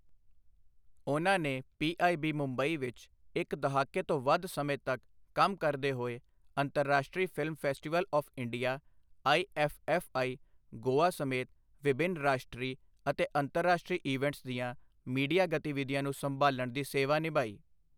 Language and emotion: Punjabi, neutral